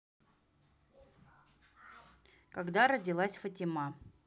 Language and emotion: Russian, neutral